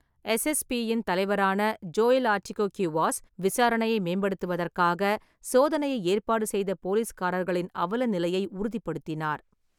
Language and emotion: Tamil, neutral